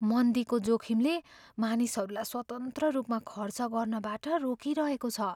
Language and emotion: Nepali, fearful